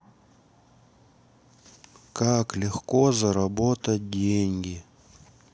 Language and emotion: Russian, sad